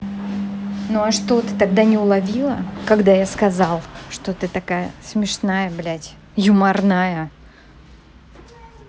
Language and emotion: Russian, angry